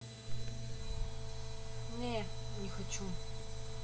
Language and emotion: Russian, neutral